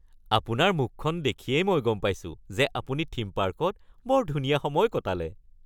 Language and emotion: Assamese, happy